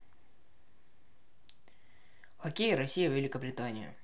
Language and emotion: Russian, neutral